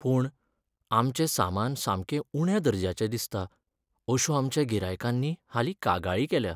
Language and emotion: Goan Konkani, sad